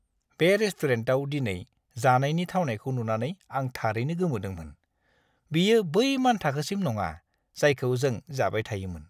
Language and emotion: Bodo, disgusted